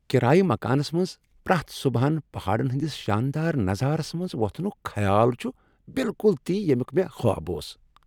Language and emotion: Kashmiri, happy